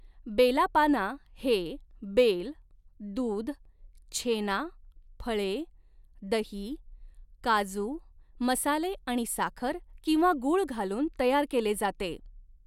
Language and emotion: Marathi, neutral